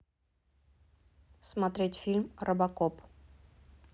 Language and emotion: Russian, neutral